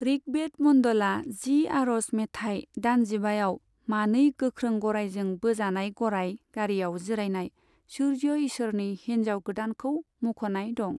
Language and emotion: Bodo, neutral